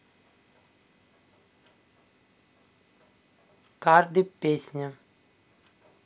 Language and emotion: Russian, neutral